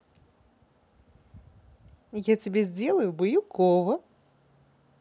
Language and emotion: Russian, positive